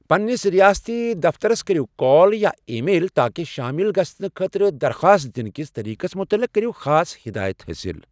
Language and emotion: Kashmiri, neutral